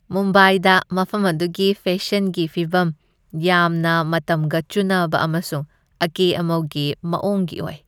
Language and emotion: Manipuri, happy